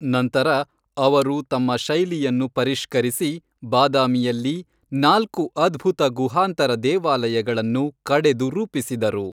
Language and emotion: Kannada, neutral